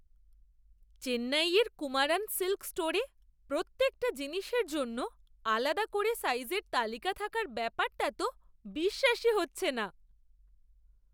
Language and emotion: Bengali, surprised